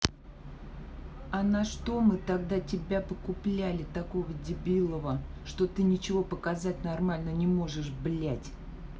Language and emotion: Russian, angry